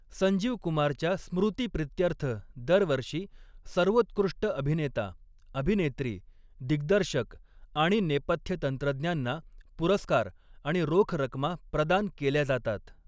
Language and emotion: Marathi, neutral